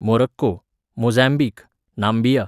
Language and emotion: Goan Konkani, neutral